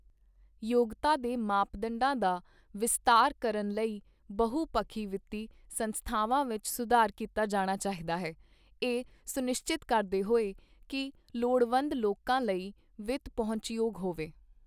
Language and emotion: Punjabi, neutral